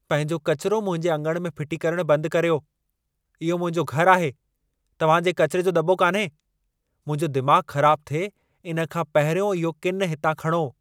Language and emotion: Sindhi, angry